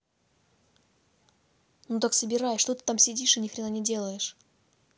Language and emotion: Russian, angry